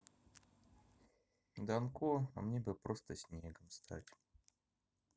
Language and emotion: Russian, neutral